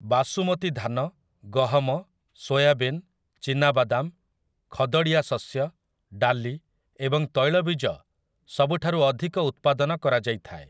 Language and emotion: Odia, neutral